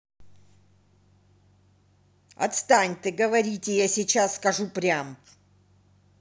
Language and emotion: Russian, angry